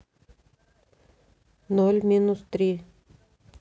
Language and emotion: Russian, neutral